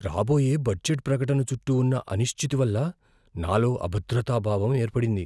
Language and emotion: Telugu, fearful